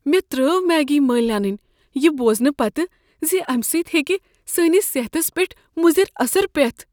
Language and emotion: Kashmiri, fearful